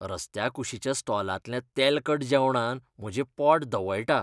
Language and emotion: Goan Konkani, disgusted